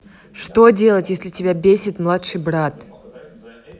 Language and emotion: Russian, angry